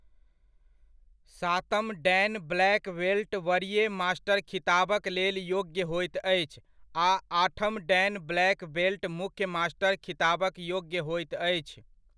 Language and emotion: Maithili, neutral